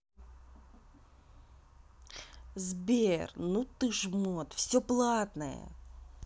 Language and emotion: Russian, angry